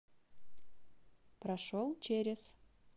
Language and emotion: Russian, neutral